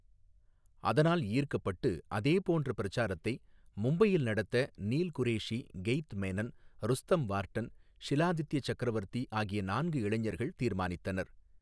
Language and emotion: Tamil, neutral